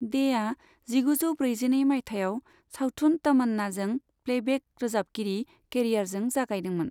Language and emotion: Bodo, neutral